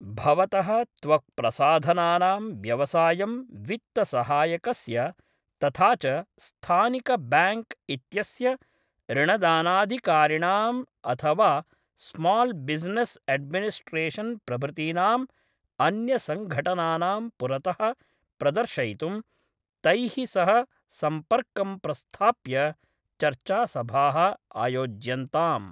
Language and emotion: Sanskrit, neutral